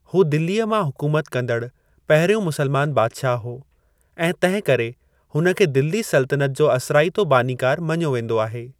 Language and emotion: Sindhi, neutral